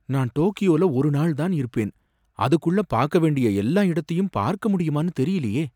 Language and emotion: Tamil, fearful